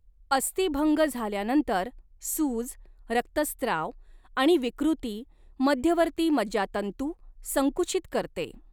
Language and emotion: Marathi, neutral